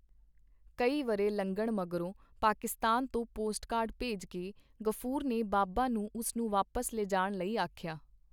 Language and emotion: Punjabi, neutral